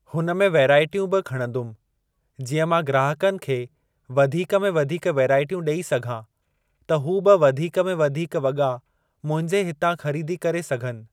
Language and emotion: Sindhi, neutral